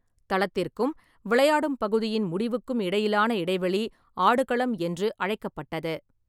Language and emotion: Tamil, neutral